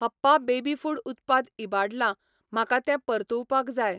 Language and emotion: Goan Konkani, neutral